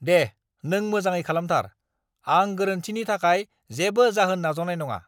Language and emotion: Bodo, angry